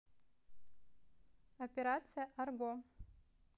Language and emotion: Russian, neutral